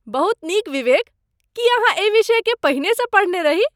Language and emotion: Maithili, surprised